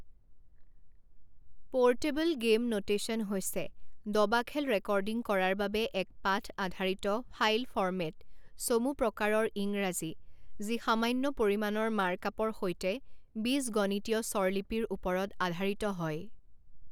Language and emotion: Assamese, neutral